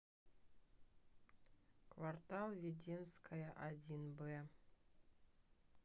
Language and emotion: Russian, neutral